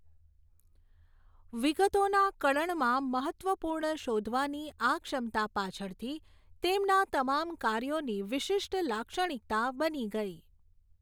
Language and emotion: Gujarati, neutral